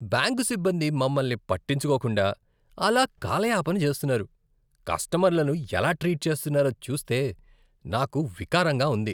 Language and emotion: Telugu, disgusted